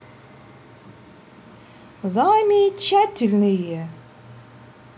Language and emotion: Russian, positive